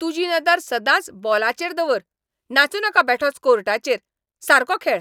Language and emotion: Goan Konkani, angry